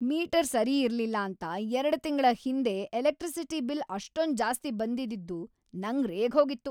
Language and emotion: Kannada, angry